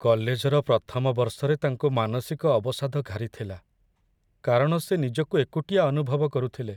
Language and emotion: Odia, sad